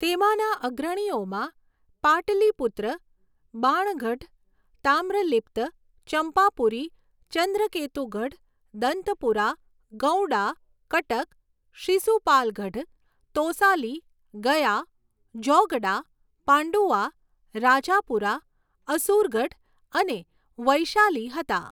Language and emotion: Gujarati, neutral